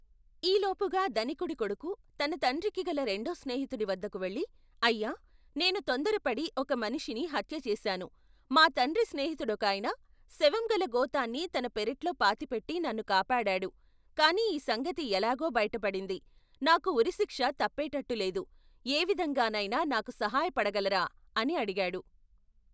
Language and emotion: Telugu, neutral